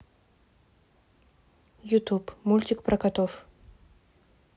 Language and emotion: Russian, neutral